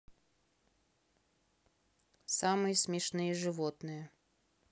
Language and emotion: Russian, neutral